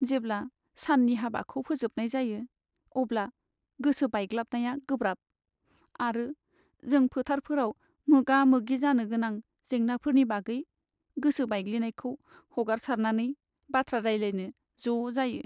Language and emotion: Bodo, sad